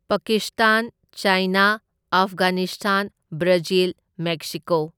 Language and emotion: Manipuri, neutral